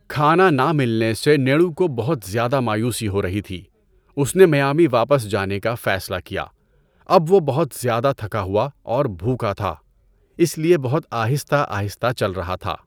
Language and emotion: Urdu, neutral